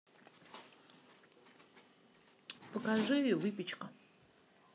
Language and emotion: Russian, neutral